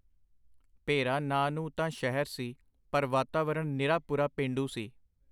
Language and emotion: Punjabi, neutral